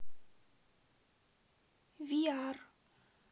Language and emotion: Russian, neutral